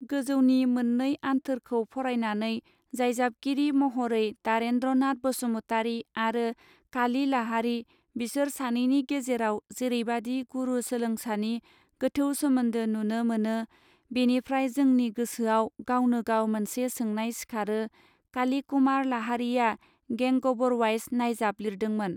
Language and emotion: Bodo, neutral